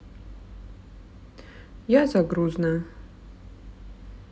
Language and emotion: Russian, sad